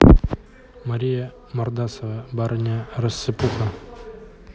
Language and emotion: Russian, neutral